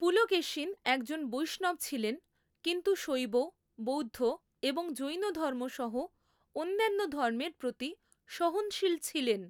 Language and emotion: Bengali, neutral